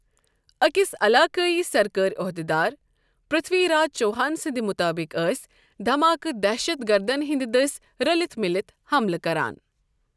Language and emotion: Kashmiri, neutral